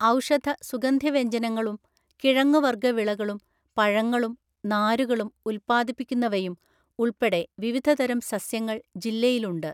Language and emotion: Malayalam, neutral